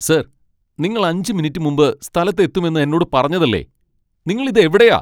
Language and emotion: Malayalam, angry